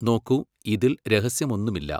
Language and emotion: Malayalam, neutral